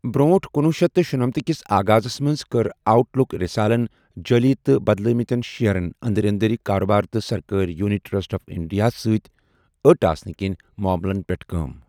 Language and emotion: Kashmiri, neutral